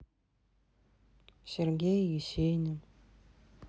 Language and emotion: Russian, sad